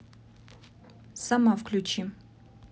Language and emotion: Russian, neutral